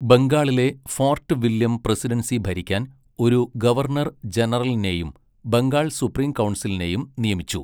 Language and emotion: Malayalam, neutral